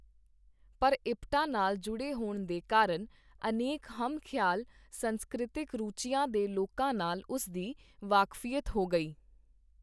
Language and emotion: Punjabi, neutral